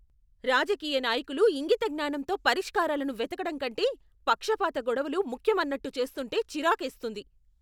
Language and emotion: Telugu, angry